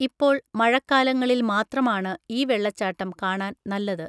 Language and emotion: Malayalam, neutral